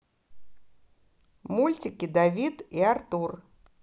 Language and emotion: Russian, neutral